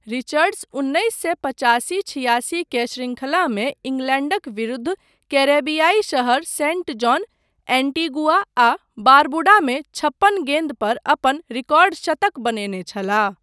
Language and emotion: Maithili, neutral